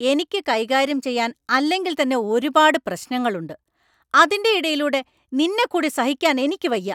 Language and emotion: Malayalam, angry